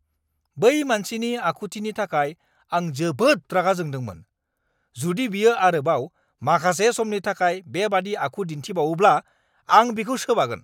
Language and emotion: Bodo, angry